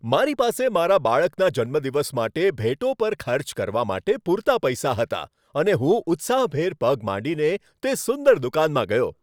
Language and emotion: Gujarati, happy